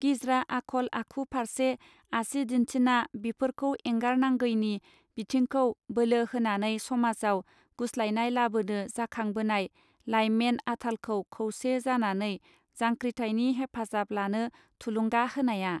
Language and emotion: Bodo, neutral